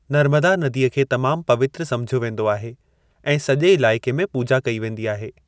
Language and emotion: Sindhi, neutral